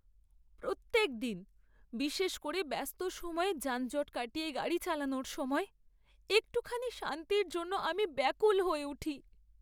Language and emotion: Bengali, sad